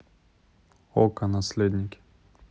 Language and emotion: Russian, neutral